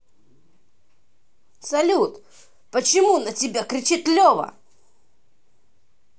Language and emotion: Russian, angry